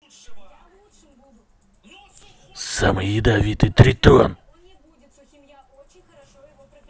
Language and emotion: Russian, angry